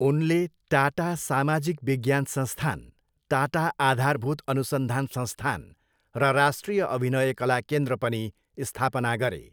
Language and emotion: Nepali, neutral